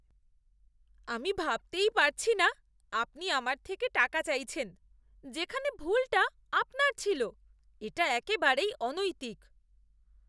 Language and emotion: Bengali, disgusted